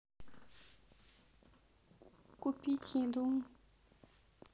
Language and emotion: Russian, sad